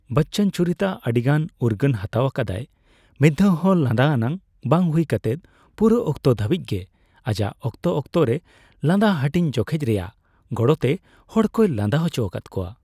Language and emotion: Santali, neutral